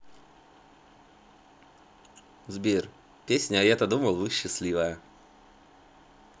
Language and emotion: Russian, positive